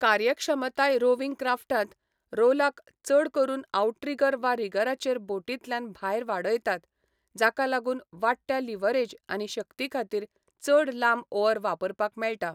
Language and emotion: Goan Konkani, neutral